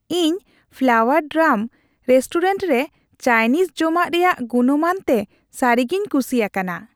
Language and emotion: Santali, happy